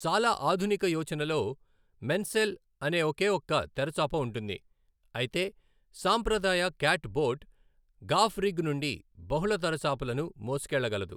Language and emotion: Telugu, neutral